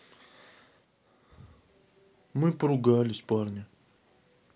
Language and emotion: Russian, sad